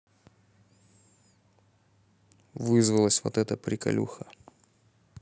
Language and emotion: Russian, neutral